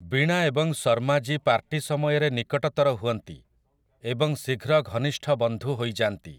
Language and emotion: Odia, neutral